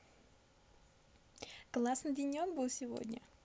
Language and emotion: Russian, positive